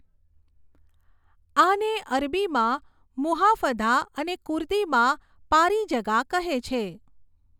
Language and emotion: Gujarati, neutral